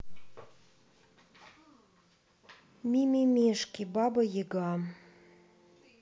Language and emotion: Russian, neutral